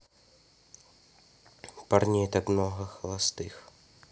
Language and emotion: Russian, neutral